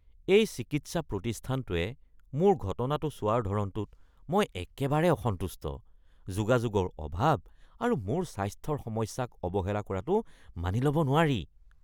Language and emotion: Assamese, disgusted